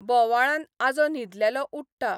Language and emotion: Goan Konkani, neutral